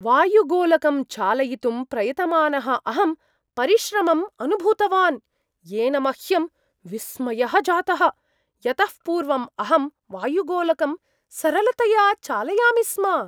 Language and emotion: Sanskrit, surprised